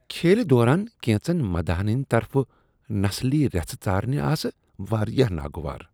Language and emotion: Kashmiri, disgusted